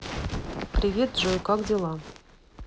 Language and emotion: Russian, neutral